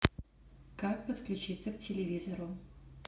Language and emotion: Russian, neutral